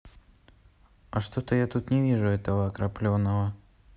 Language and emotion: Russian, neutral